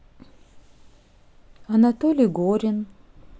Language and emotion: Russian, neutral